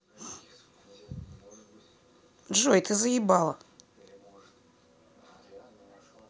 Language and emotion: Russian, neutral